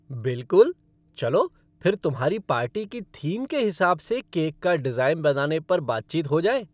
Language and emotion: Hindi, happy